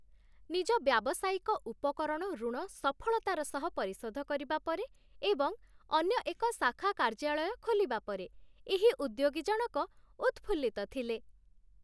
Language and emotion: Odia, happy